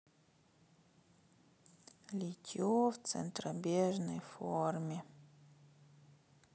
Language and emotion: Russian, sad